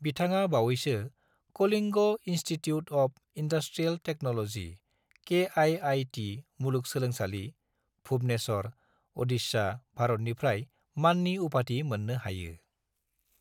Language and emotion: Bodo, neutral